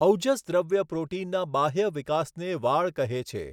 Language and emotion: Gujarati, neutral